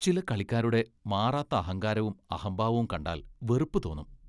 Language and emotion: Malayalam, disgusted